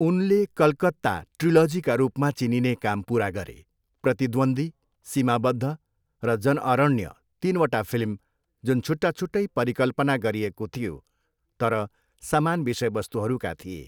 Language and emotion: Nepali, neutral